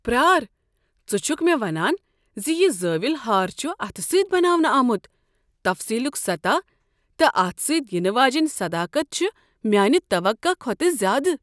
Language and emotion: Kashmiri, surprised